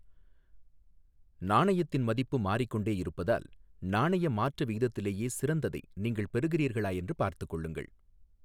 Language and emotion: Tamil, neutral